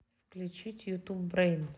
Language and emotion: Russian, neutral